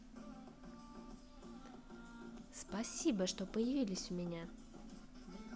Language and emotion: Russian, positive